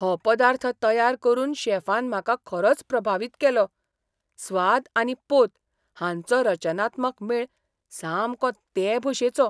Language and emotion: Goan Konkani, surprised